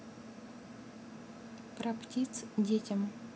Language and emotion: Russian, neutral